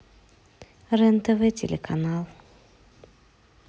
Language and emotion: Russian, neutral